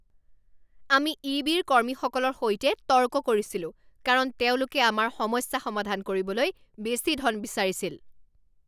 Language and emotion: Assamese, angry